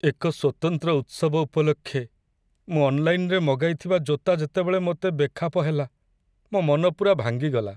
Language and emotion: Odia, sad